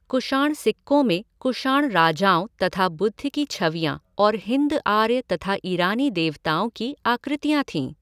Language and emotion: Hindi, neutral